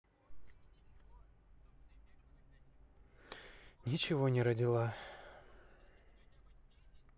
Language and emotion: Russian, sad